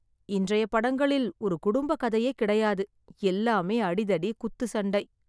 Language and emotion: Tamil, sad